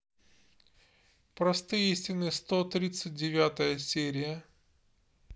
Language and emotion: Russian, neutral